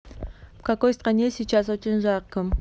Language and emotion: Russian, neutral